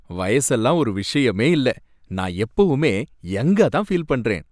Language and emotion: Tamil, happy